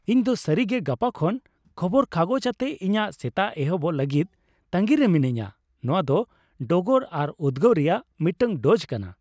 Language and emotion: Santali, happy